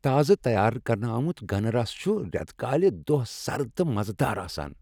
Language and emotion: Kashmiri, happy